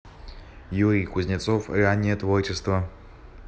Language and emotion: Russian, neutral